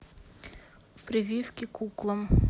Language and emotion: Russian, neutral